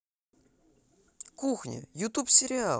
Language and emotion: Russian, positive